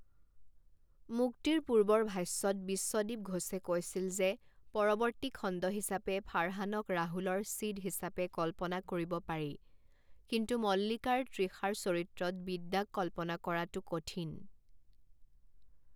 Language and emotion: Assamese, neutral